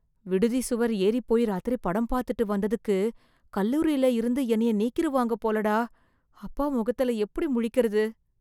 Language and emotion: Tamil, fearful